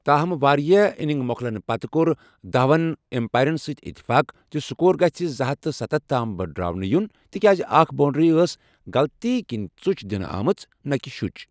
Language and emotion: Kashmiri, neutral